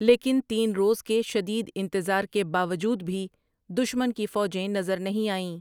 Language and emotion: Urdu, neutral